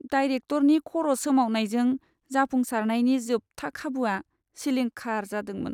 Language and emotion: Bodo, sad